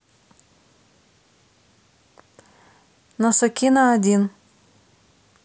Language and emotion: Russian, neutral